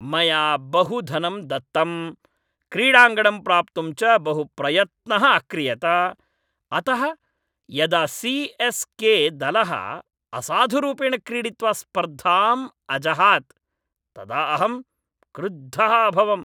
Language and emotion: Sanskrit, angry